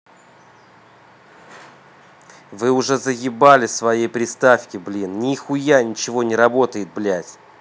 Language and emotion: Russian, angry